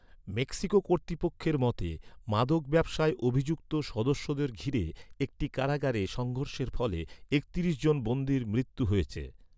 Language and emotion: Bengali, neutral